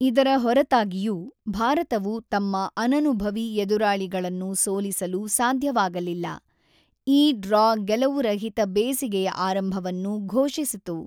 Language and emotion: Kannada, neutral